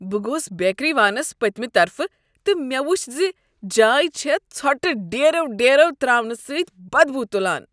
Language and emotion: Kashmiri, disgusted